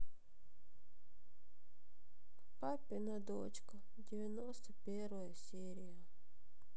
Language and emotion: Russian, sad